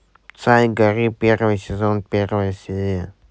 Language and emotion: Russian, neutral